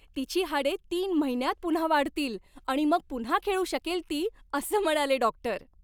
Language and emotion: Marathi, happy